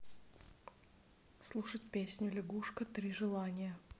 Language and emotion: Russian, neutral